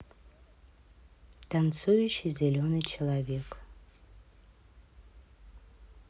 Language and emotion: Russian, neutral